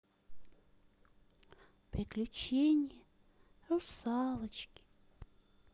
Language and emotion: Russian, sad